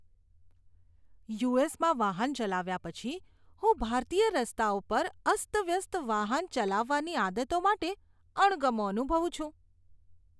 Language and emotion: Gujarati, disgusted